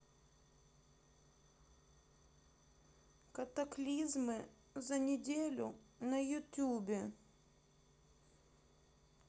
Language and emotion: Russian, sad